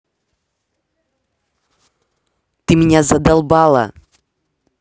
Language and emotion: Russian, angry